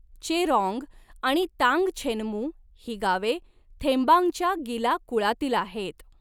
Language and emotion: Marathi, neutral